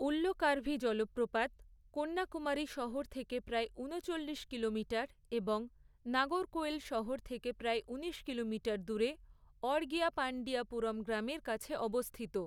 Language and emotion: Bengali, neutral